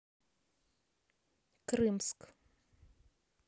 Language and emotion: Russian, neutral